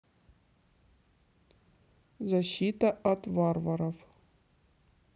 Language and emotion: Russian, neutral